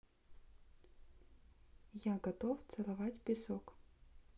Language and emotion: Russian, neutral